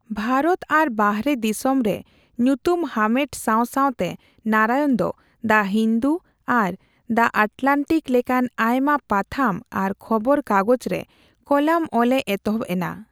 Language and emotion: Santali, neutral